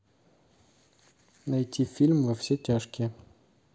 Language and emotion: Russian, neutral